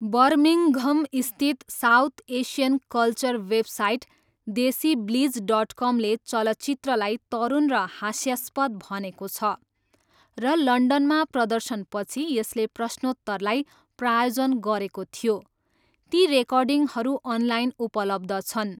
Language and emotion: Nepali, neutral